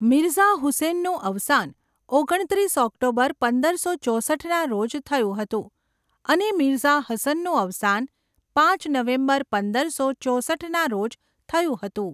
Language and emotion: Gujarati, neutral